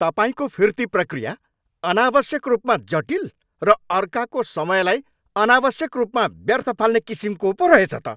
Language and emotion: Nepali, angry